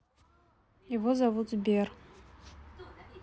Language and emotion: Russian, neutral